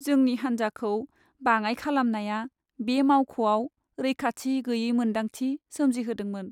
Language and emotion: Bodo, sad